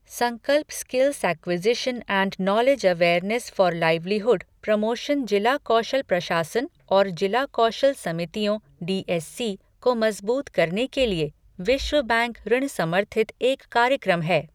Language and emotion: Hindi, neutral